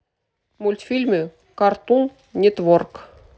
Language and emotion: Russian, neutral